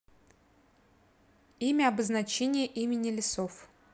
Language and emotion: Russian, neutral